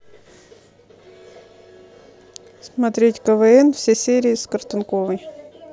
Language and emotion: Russian, neutral